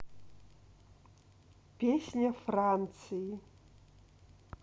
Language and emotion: Russian, neutral